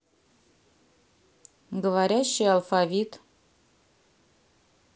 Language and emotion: Russian, neutral